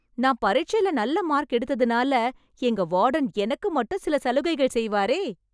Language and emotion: Tamil, happy